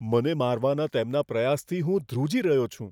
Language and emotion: Gujarati, fearful